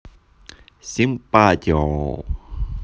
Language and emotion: Russian, positive